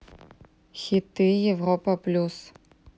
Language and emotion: Russian, neutral